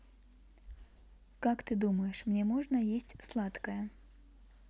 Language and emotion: Russian, neutral